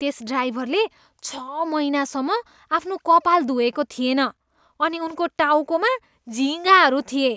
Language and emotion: Nepali, disgusted